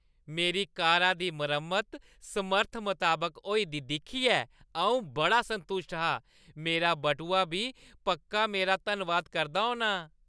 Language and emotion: Dogri, happy